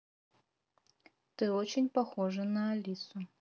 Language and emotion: Russian, neutral